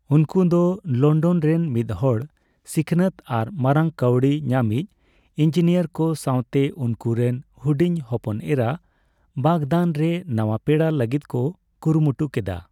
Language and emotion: Santali, neutral